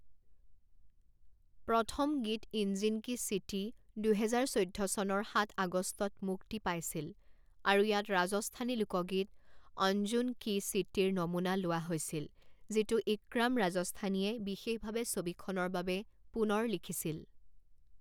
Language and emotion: Assamese, neutral